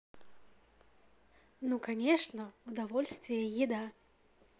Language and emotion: Russian, positive